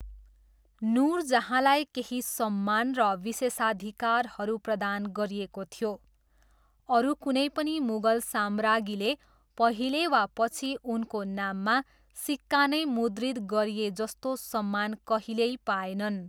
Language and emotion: Nepali, neutral